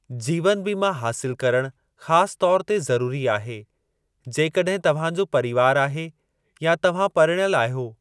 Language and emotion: Sindhi, neutral